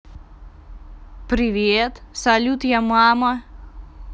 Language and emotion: Russian, positive